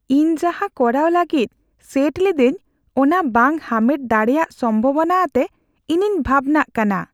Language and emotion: Santali, fearful